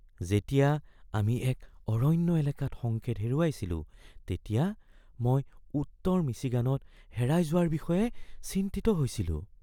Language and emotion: Assamese, fearful